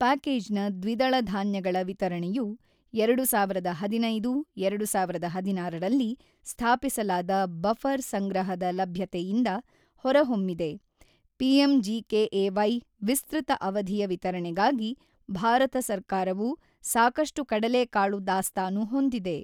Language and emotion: Kannada, neutral